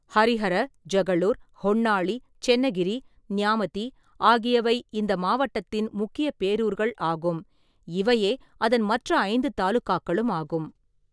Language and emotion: Tamil, neutral